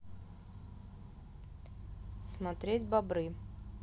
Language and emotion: Russian, neutral